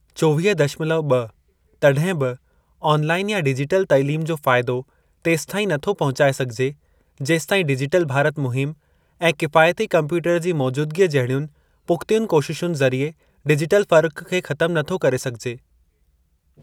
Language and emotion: Sindhi, neutral